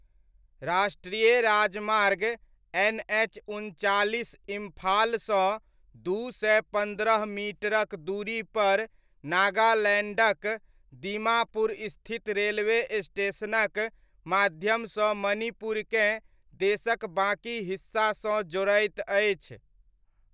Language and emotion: Maithili, neutral